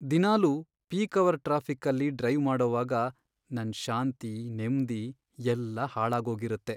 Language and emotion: Kannada, sad